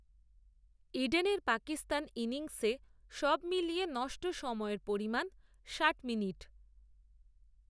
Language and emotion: Bengali, neutral